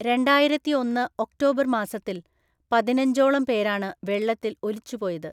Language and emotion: Malayalam, neutral